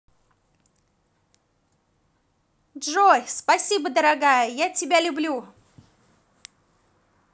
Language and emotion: Russian, positive